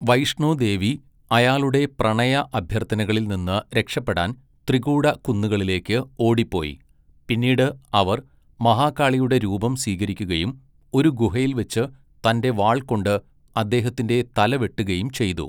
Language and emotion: Malayalam, neutral